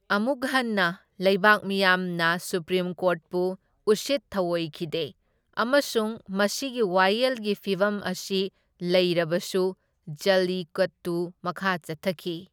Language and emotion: Manipuri, neutral